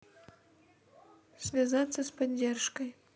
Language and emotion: Russian, neutral